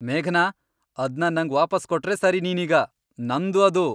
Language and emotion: Kannada, angry